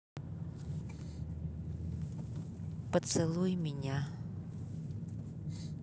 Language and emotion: Russian, neutral